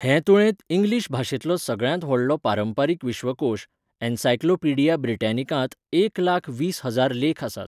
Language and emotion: Goan Konkani, neutral